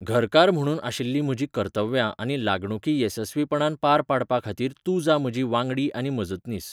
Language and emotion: Goan Konkani, neutral